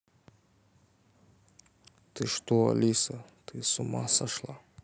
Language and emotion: Russian, neutral